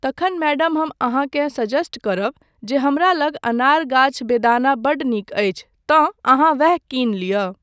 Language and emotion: Maithili, neutral